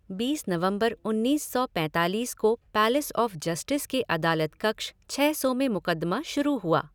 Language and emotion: Hindi, neutral